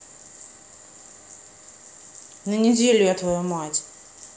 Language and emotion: Russian, angry